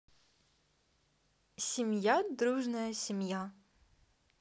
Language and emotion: Russian, neutral